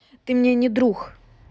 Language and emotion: Russian, neutral